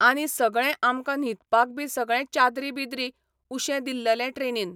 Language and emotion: Goan Konkani, neutral